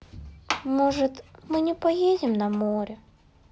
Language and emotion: Russian, sad